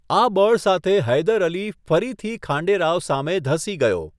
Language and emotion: Gujarati, neutral